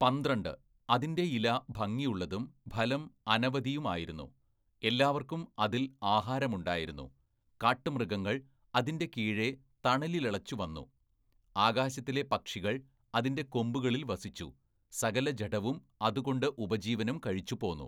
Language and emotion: Malayalam, neutral